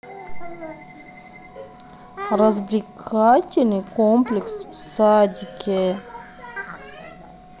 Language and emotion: Russian, neutral